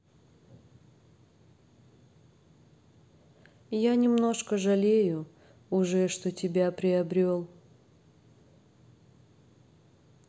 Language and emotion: Russian, sad